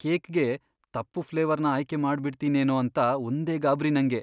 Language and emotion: Kannada, fearful